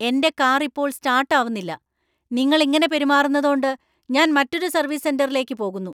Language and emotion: Malayalam, angry